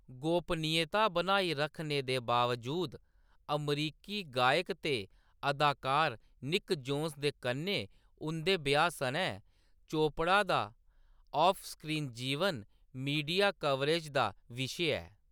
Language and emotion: Dogri, neutral